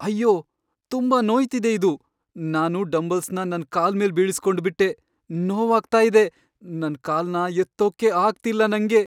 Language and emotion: Kannada, sad